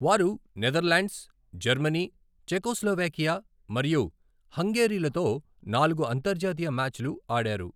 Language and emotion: Telugu, neutral